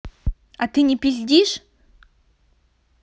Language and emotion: Russian, angry